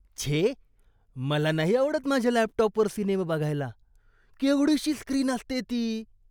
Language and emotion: Marathi, disgusted